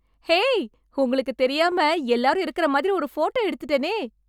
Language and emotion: Tamil, happy